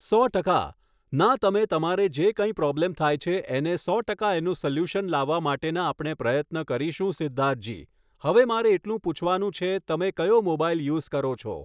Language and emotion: Gujarati, neutral